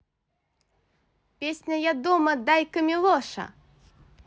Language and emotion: Russian, positive